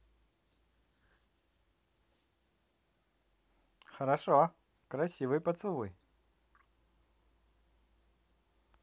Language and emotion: Russian, positive